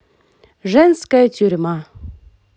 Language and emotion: Russian, positive